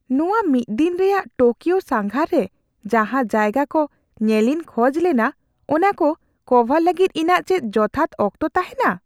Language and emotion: Santali, fearful